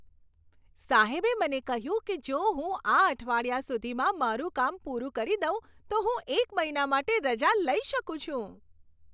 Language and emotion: Gujarati, happy